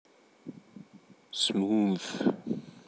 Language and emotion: Russian, neutral